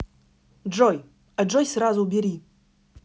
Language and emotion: Russian, angry